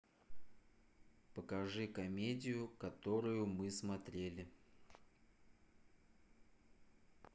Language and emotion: Russian, neutral